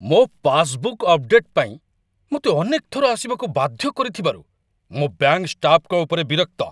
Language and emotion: Odia, angry